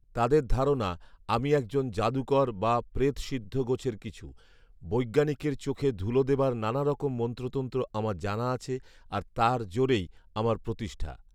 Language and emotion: Bengali, neutral